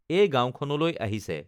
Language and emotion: Assamese, neutral